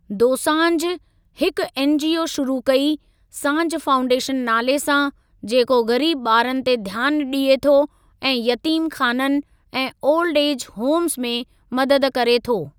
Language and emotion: Sindhi, neutral